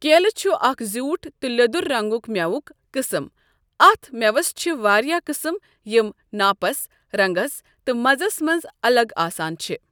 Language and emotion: Kashmiri, neutral